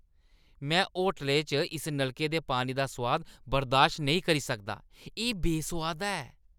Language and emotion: Dogri, disgusted